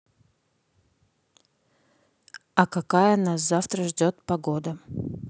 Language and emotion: Russian, neutral